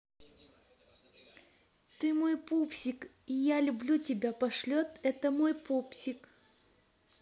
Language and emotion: Russian, positive